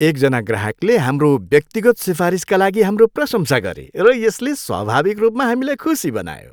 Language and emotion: Nepali, happy